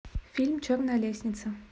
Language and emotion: Russian, neutral